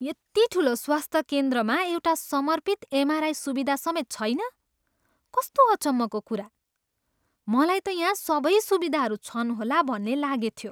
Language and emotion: Nepali, surprised